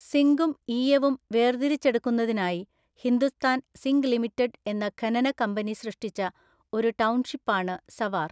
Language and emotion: Malayalam, neutral